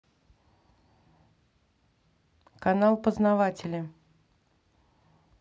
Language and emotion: Russian, neutral